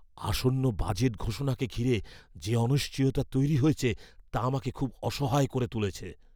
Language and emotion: Bengali, fearful